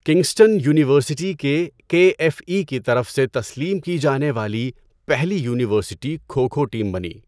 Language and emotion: Urdu, neutral